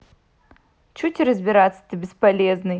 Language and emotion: Russian, angry